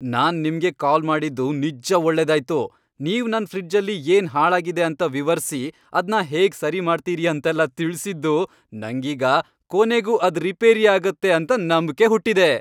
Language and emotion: Kannada, happy